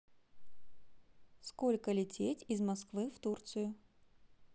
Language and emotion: Russian, neutral